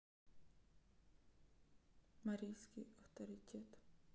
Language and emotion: Russian, neutral